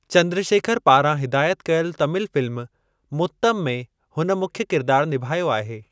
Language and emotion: Sindhi, neutral